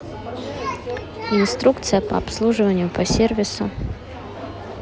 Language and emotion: Russian, neutral